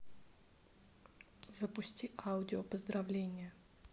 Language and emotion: Russian, neutral